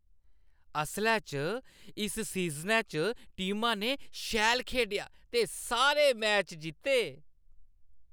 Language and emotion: Dogri, happy